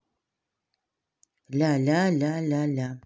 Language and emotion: Russian, neutral